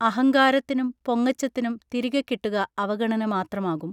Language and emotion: Malayalam, neutral